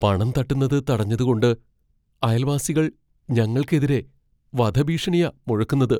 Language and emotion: Malayalam, fearful